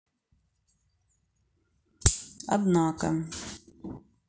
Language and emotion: Russian, neutral